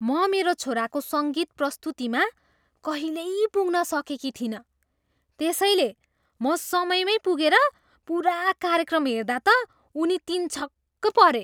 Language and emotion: Nepali, surprised